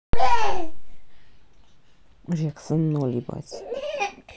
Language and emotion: Russian, neutral